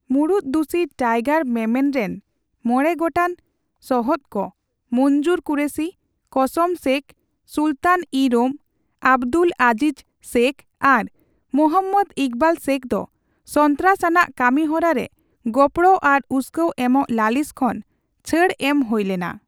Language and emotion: Santali, neutral